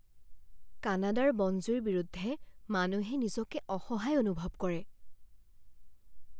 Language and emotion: Assamese, fearful